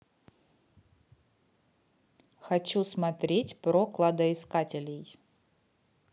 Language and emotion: Russian, neutral